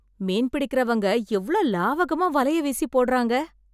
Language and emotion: Tamil, surprised